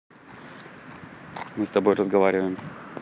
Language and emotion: Russian, neutral